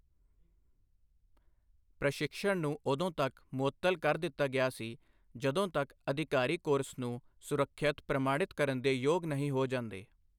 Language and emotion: Punjabi, neutral